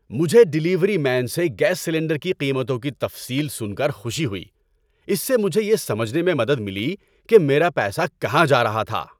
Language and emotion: Urdu, happy